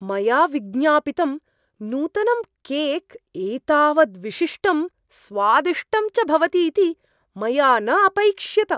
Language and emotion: Sanskrit, surprised